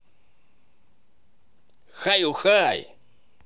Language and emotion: Russian, positive